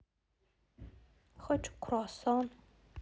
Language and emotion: Russian, sad